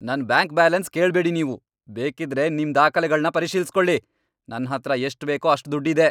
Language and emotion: Kannada, angry